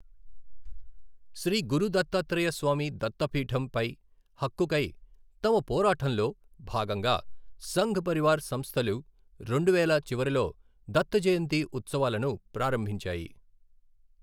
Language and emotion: Telugu, neutral